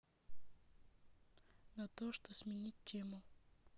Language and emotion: Russian, neutral